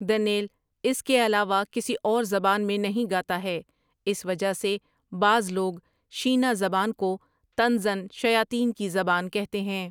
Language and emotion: Urdu, neutral